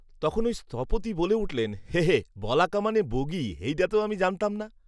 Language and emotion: Bengali, neutral